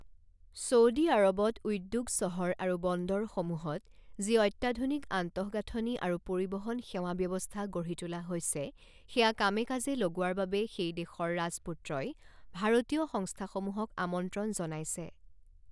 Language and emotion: Assamese, neutral